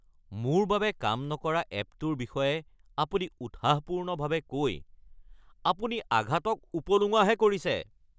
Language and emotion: Assamese, angry